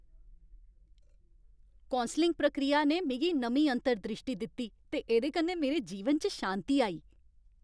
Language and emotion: Dogri, happy